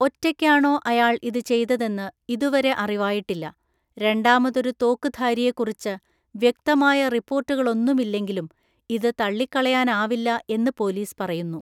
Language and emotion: Malayalam, neutral